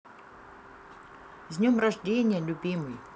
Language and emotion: Russian, positive